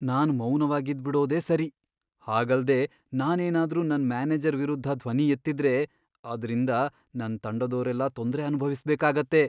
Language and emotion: Kannada, fearful